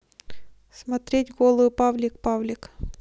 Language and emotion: Russian, neutral